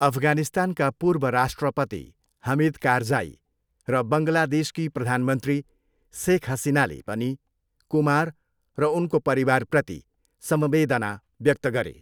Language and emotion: Nepali, neutral